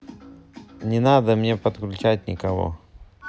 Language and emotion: Russian, neutral